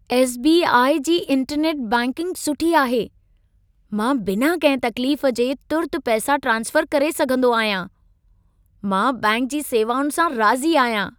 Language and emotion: Sindhi, happy